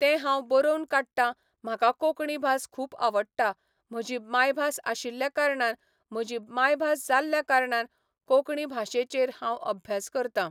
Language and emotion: Goan Konkani, neutral